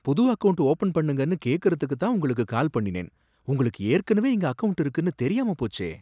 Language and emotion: Tamil, surprised